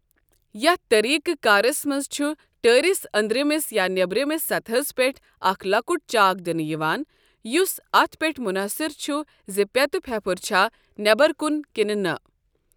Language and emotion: Kashmiri, neutral